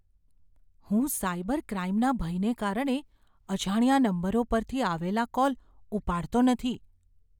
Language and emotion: Gujarati, fearful